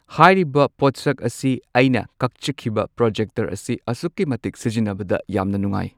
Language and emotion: Manipuri, neutral